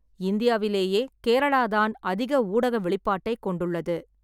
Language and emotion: Tamil, neutral